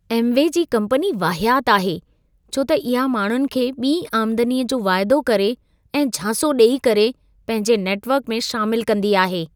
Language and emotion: Sindhi, disgusted